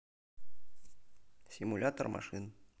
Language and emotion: Russian, neutral